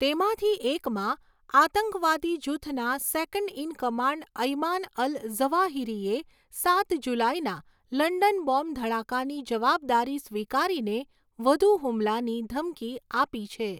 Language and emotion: Gujarati, neutral